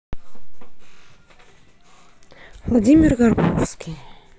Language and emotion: Russian, neutral